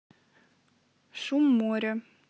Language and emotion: Russian, neutral